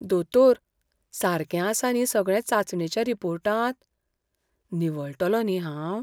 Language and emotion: Goan Konkani, fearful